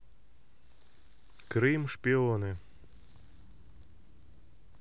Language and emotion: Russian, neutral